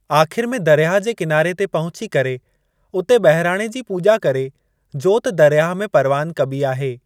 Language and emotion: Sindhi, neutral